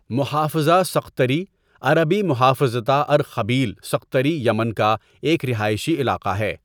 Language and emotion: Urdu, neutral